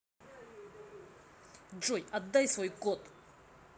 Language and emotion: Russian, angry